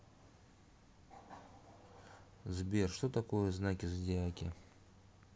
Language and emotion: Russian, neutral